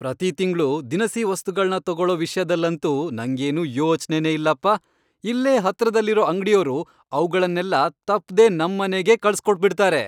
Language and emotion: Kannada, happy